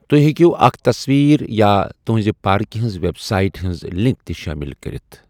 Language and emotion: Kashmiri, neutral